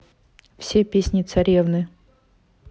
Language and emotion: Russian, neutral